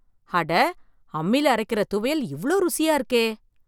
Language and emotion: Tamil, surprised